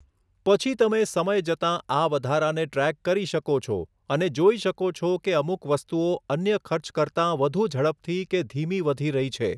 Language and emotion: Gujarati, neutral